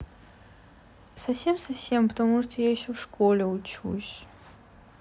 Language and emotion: Russian, sad